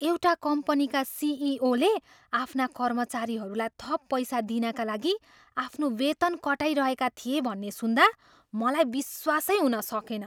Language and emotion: Nepali, surprised